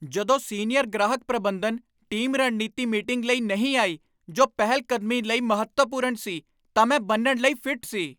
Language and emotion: Punjabi, angry